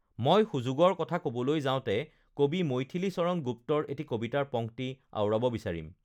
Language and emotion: Assamese, neutral